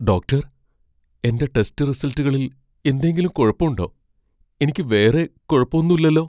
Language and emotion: Malayalam, fearful